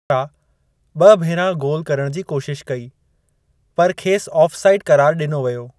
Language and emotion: Sindhi, neutral